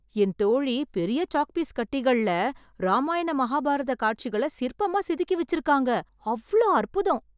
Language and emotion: Tamil, surprised